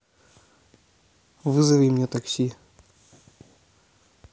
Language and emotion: Russian, neutral